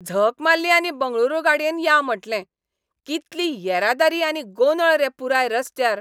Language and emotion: Goan Konkani, angry